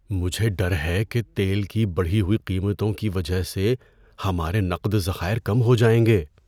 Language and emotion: Urdu, fearful